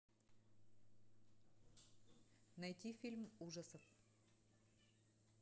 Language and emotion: Russian, neutral